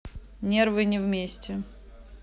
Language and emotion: Russian, neutral